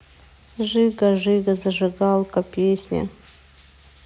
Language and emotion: Russian, sad